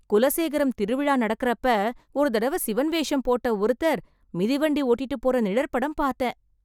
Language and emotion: Tamil, surprised